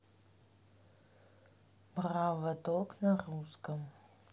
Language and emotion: Russian, neutral